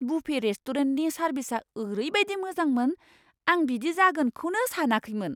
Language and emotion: Bodo, surprised